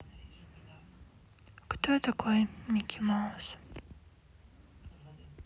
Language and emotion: Russian, sad